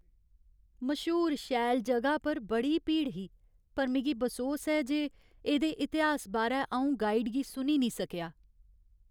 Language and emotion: Dogri, sad